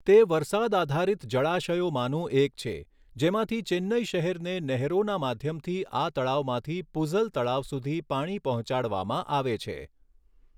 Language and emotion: Gujarati, neutral